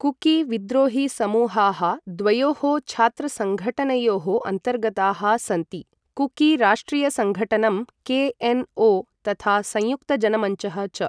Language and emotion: Sanskrit, neutral